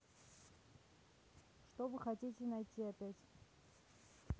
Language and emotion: Russian, neutral